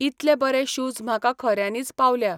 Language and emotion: Goan Konkani, neutral